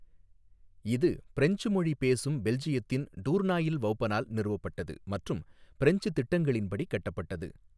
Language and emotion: Tamil, neutral